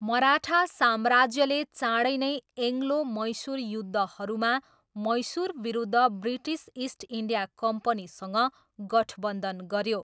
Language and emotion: Nepali, neutral